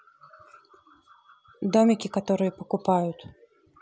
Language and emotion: Russian, neutral